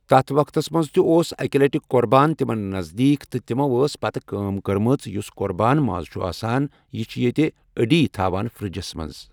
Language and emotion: Kashmiri, neutral